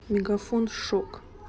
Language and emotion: Russian, neutral